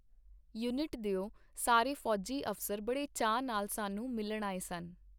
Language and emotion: Punjabi, neutral